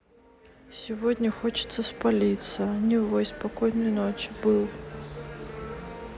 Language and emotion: Russian, sad